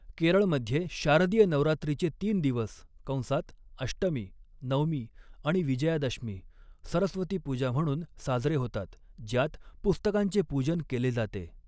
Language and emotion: Marathi, neutral